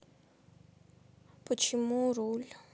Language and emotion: Russian, sad